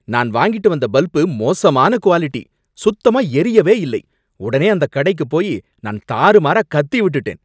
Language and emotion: Tamil, angry